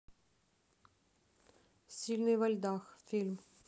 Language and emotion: Russian, neutral